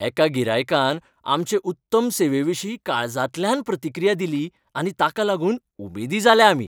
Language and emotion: Goan Konkani, happy